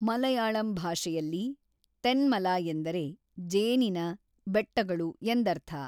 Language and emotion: Kannada, neutral